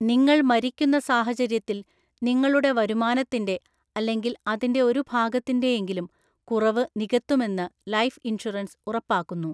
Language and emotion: Malayalam, neutral